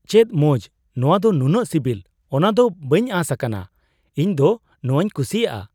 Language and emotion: Santali, surprised